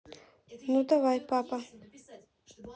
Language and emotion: Russian, neutral